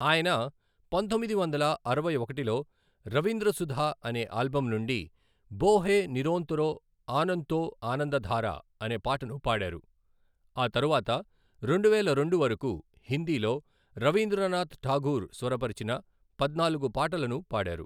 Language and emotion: Telugu, neutral